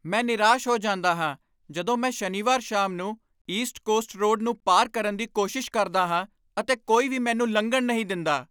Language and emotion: Punjabi, angry